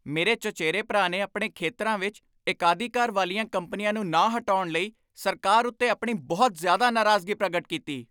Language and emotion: Punjabi, angry